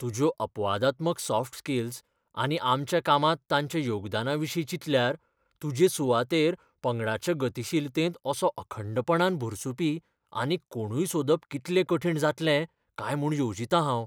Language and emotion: Goan Konkani, fearful